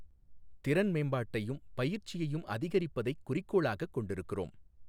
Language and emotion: Tamil, neutral